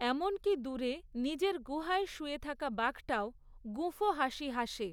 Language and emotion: Bengali, neutral